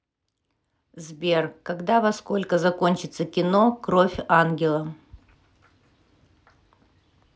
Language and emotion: Russian, neutral